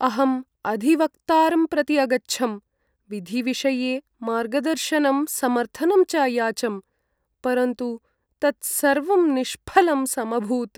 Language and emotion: Sanskrit, sad